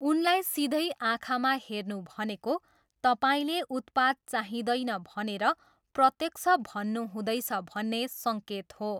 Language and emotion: Nepali, neutral